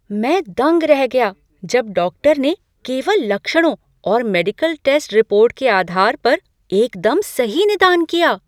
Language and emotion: Hindi, surprised